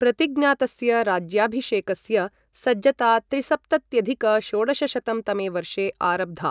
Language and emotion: Sanskrit, neutral